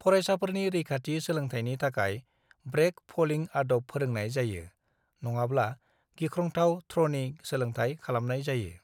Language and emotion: Bodo, neutral